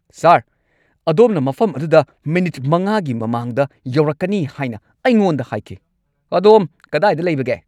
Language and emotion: Manipuri, angry